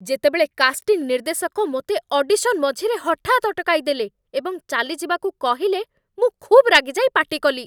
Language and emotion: Odia, angry